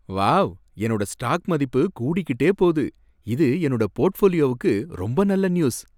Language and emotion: Tamil, happy